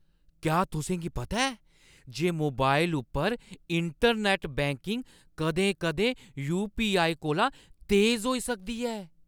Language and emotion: Dogri, surprised